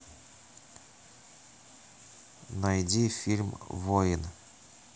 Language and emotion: Russian, neutral